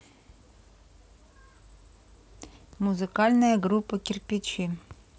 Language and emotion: Russian, neutral